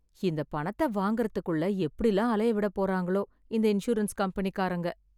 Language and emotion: Tamil, sad